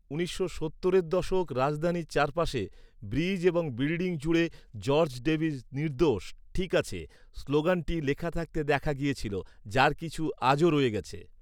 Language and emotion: Bengali, neutral